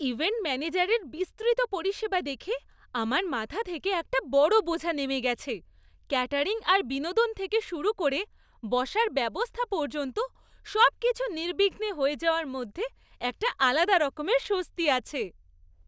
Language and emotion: Bengali, happy